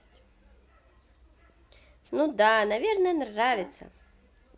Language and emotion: Russian, positive